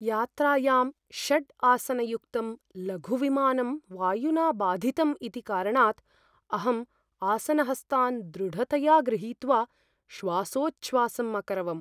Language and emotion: Sanskrit, fearful